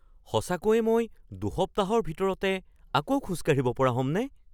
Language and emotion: Assamese, surprised